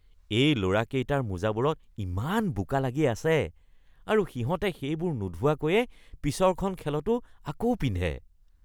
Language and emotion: Assamese, disgusted